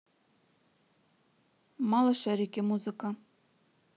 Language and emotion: Russian, neutral